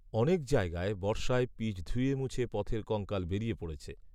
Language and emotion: Bengali, neutral